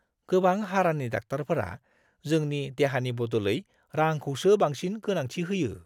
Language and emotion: Bodo, disgusted